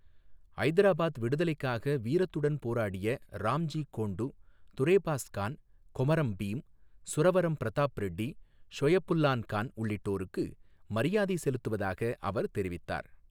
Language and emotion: Tamil, neutral